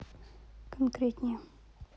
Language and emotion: Russian, neutral